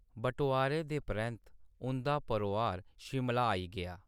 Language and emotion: Dogri, neutral